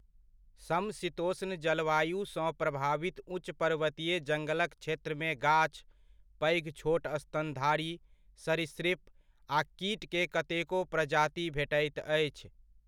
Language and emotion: Maithili, neutral